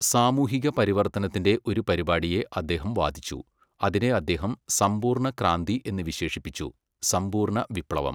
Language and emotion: Malayalam, neutral